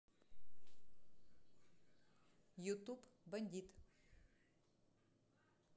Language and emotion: Russian, neutral